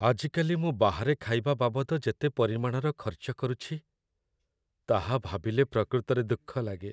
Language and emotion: Odia, sad